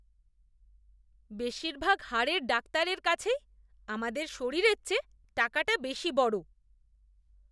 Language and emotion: Bengali, disgusted